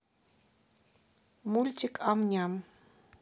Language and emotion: Russian, neutral